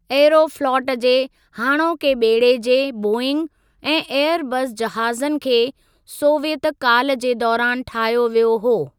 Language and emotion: Sindhi, neutral